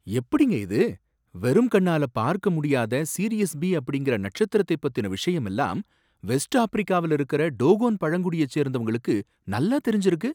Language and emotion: Tamil, surprised